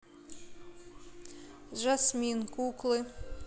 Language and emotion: Russian, neutral